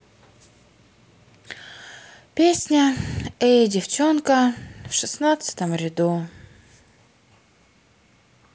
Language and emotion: Russian, sad